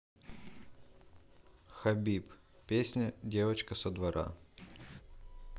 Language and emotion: Russian, neutral